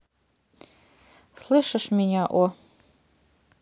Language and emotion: Russian, neutral